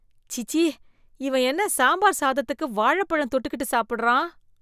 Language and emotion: Tamil, disgusted